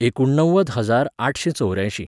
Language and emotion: Goan Konkani, neutral